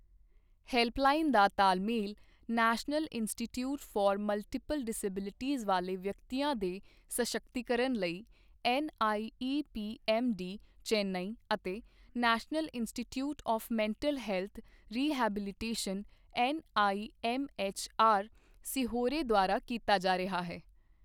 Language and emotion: Punjabi, neutral